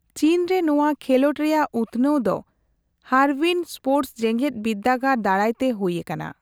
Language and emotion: Santali, neutral